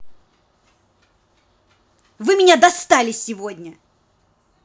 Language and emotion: Russian, angry